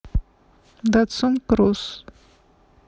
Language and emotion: Russian, neutral